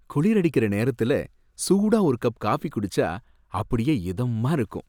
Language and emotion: Tamil, happy